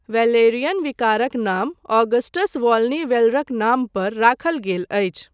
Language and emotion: Maithili, neutral